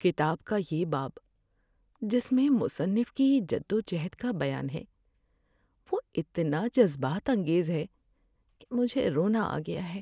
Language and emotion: Urdu, sad